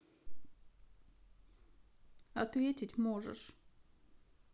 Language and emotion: Russian, sad